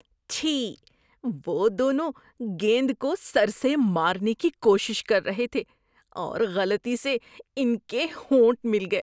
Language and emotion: Urdu, disgusted